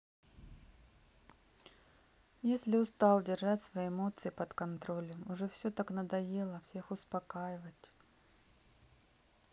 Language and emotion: Russian, sad